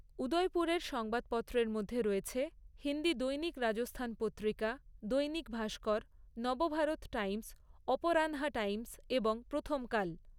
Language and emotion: Bengali, neutral